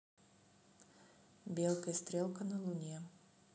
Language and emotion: Russian, neutral